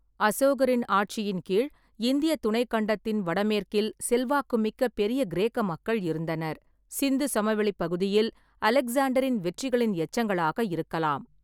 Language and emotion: Tamil, neutral